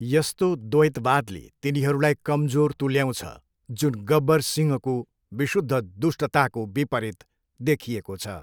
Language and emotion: Nepali, neutral